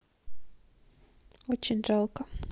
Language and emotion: Russian, sad